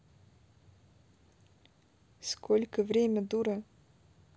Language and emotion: Russian, neutral